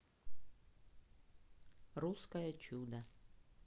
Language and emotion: Russian, neutral